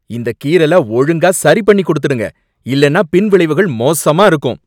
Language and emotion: Tamil, angry